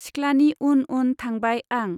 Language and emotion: Bodo, neutral